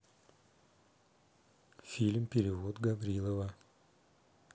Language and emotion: Russian, neutral